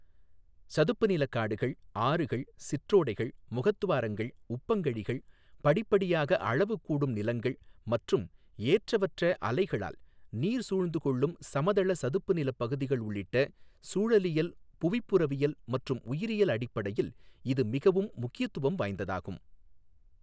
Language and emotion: Tamil, neutral